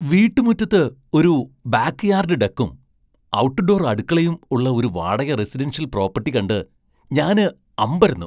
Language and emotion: Malayalam, surprised